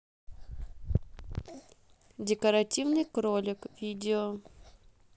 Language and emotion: Russian, neutral